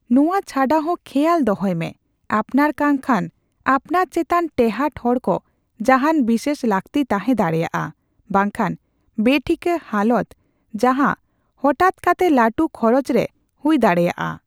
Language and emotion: Santali, neutral